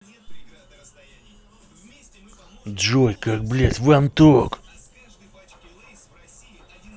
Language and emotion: Russian, angry